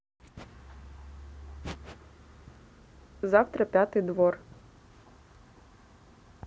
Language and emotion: Russian, neutral